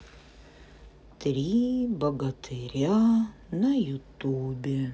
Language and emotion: Russian, sad